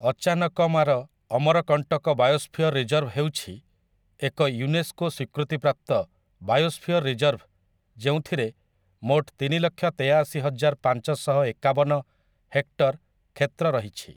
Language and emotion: Odia, neutral